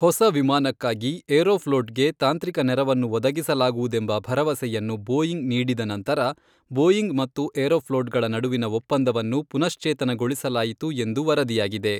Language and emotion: Kannada, neutral